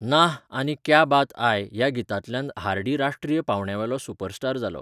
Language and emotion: Goan Konkani, neutral